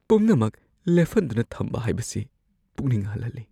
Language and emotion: Manipuri, fearful